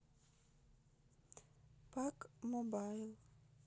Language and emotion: Russian, neutral